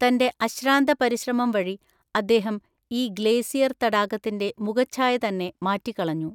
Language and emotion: Malayalam, neutral